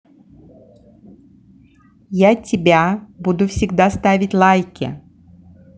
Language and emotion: Russian, positive